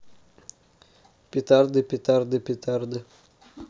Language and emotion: Russian, neutral